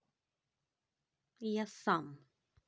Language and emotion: Russian, angry